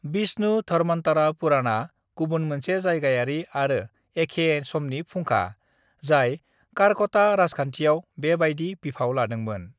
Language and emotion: Bodo, neutral